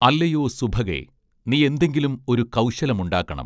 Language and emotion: Malayalam, neutral